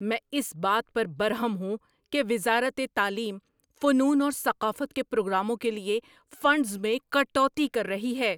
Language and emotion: Urdu, angry